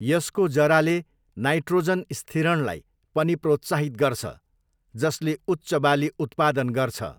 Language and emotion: Nepali, neutral